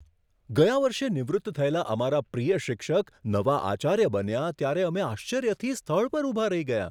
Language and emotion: Gujarati, surprised